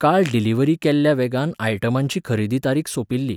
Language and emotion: Goan Konkani, neutral